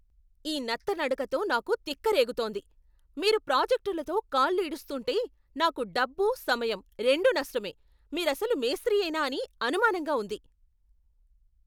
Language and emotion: Telugu, angry